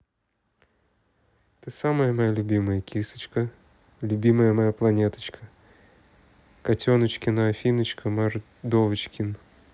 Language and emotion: Russian, neutral